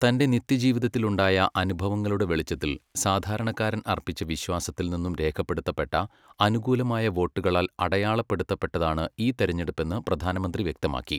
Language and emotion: Malayalam, neutral